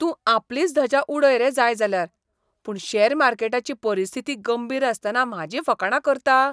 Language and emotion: Goan Konkani, disgusted